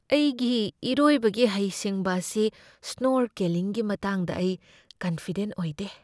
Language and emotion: Manipuri, fearful